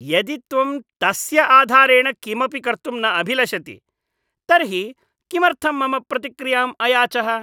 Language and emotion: Sanskrit, disgusted